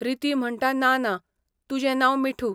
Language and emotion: Goan Konkani, neutral